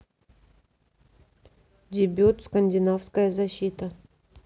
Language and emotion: Russian, neutral